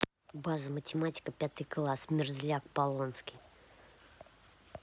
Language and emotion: Russian, angry